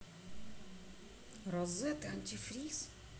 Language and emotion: Russian, neutral